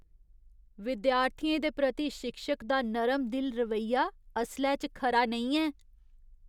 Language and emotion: Dogri, disgusted